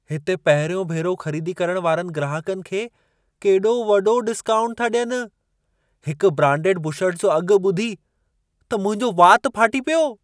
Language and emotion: Sindhi, surprised